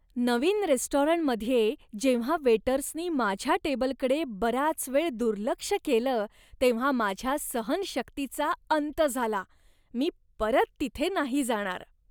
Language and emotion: Marathi, disgusted